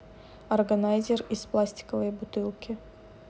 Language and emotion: Russian, neutral